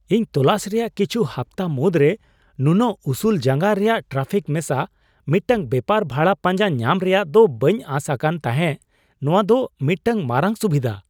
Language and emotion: Santali, surprised